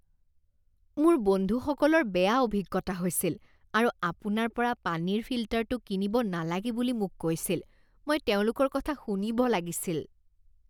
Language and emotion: Assamese, disgusted